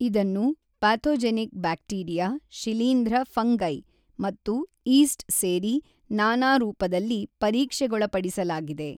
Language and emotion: Kannada, neutral